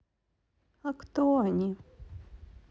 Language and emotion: Russian, sad